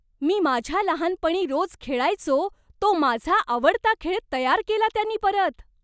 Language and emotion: Marathi, surprised